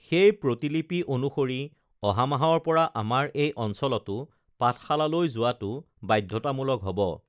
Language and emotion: Assamese, neutral